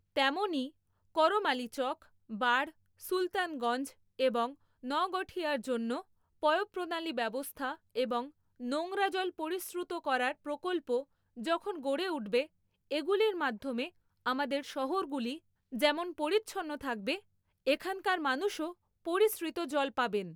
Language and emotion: Bengali, neutral